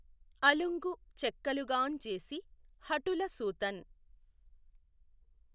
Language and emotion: Telugu, neutral